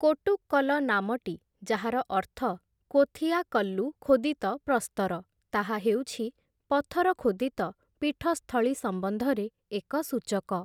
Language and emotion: Odia, neutral